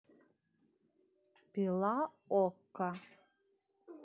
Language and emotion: Russian, neutral